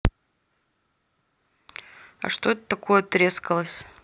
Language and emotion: Russian, neutral